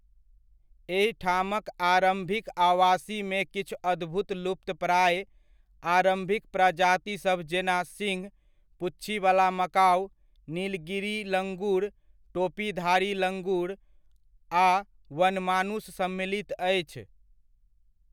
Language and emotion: Maithili, neutral